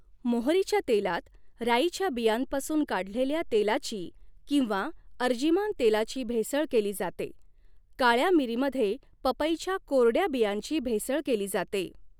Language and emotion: Marathi, neutral